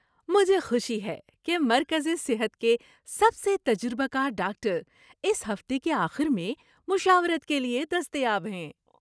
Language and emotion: Urdu, happy